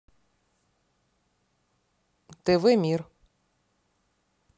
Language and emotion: Russian, angry